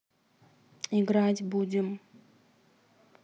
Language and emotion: Russian, neutral